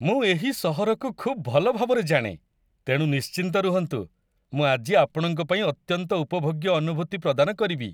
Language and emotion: Odia, happy